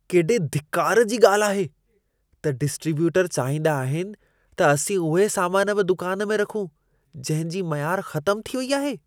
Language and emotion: Sindhi, disgusted